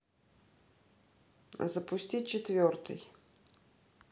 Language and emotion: Russian, neutral